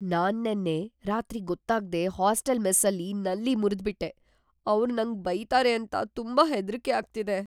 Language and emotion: Kannada, fearful